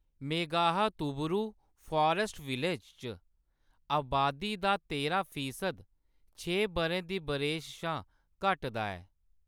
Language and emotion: Dogri, neutral